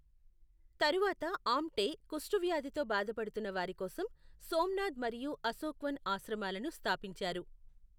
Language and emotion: Telugu, neutral